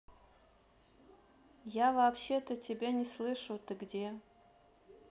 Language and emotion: Russian, neutral